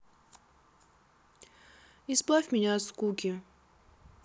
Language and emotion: Russian, neutral